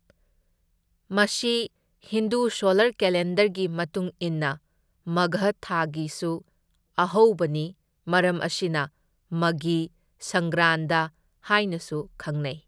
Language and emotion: Manipuri, neutral